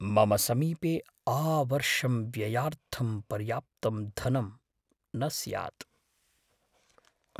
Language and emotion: Sanskrit, fearful